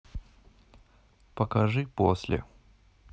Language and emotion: Russian, neutral